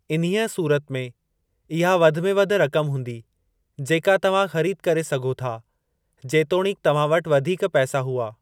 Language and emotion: Sindhi, neutral